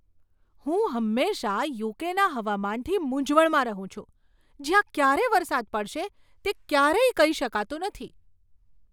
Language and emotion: Gujarati, surprised